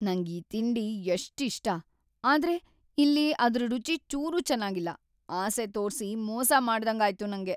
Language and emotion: Kannada, sad